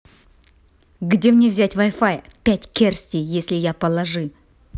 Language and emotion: Russian, angry